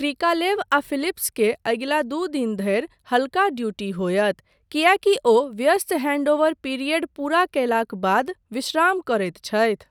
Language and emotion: Maithili, neutral